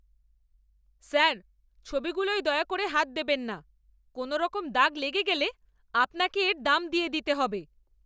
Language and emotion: Bengali, angry